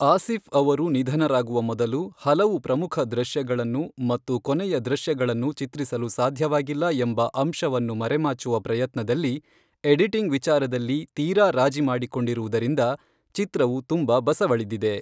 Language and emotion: Kannada, neutral